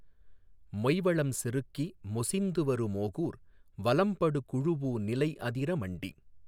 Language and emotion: Tamil, neutral